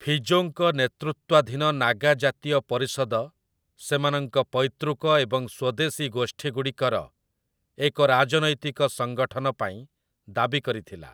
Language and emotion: Odia, neutral